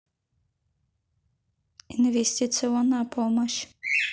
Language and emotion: Russian, neutral